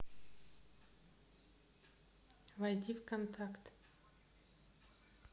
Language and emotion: Russian, neutral